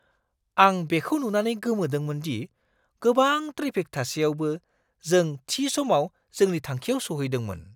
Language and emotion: Bodo, surprised